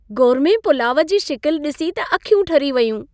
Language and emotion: Sindhi, happy